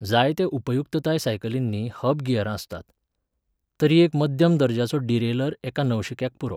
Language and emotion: Goan Konkani, neutral